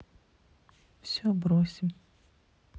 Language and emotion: Russian, sad